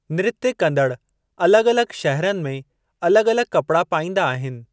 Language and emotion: Sindhi, neutral